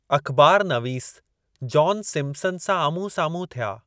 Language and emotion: Sindhi, neutral